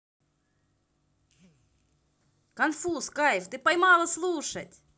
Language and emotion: Russian, positive